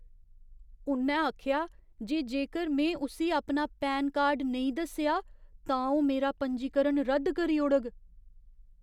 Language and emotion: Dogri, fearful